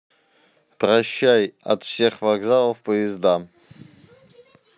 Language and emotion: Russian, neutral